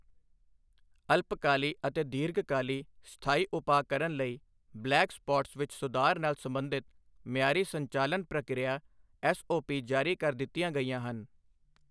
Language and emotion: Punjabi, neutral